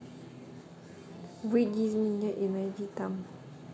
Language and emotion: Russian, neutral